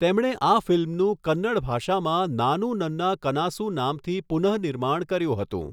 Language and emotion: Gujarati, neutral